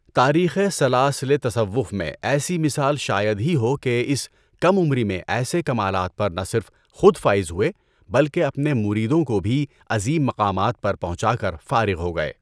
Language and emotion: Urdu, neutral